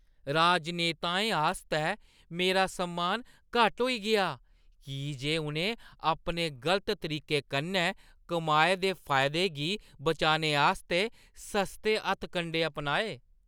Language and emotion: Dogri, disgusted